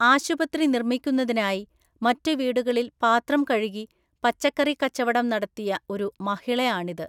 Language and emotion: Malayalam, neutral